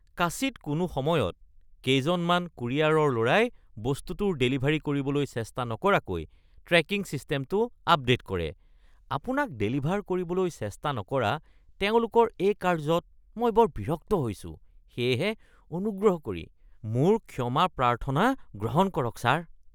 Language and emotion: Assamese, disgusted